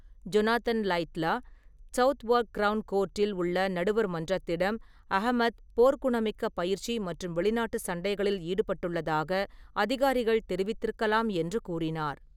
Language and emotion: Tamil, neutral